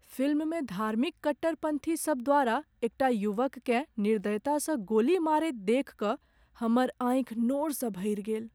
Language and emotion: Maithili, sad